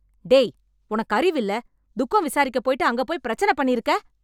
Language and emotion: Tamil, angry